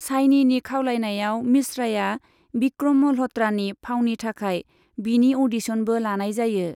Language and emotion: Bodo, neutral